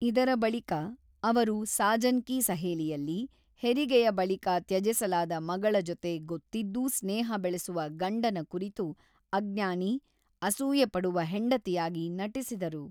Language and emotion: Kannada, neutral